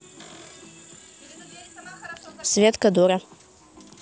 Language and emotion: Russian, neutral